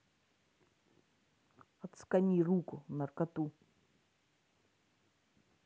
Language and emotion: Russian, neutral